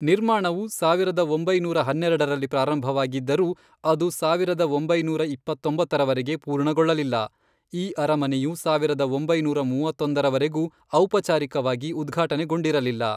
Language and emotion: Kannada, neutral